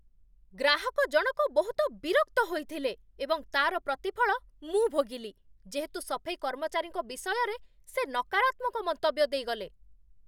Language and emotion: Odia, angry